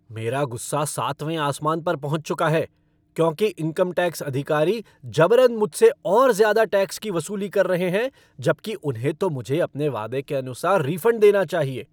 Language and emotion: Hindi, angry